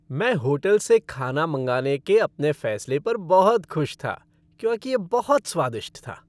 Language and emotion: Hindi, happy